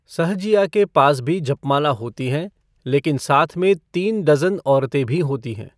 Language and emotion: Hindi, neutral